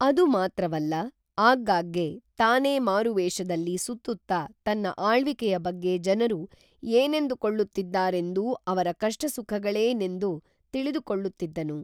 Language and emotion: Kannada, neutral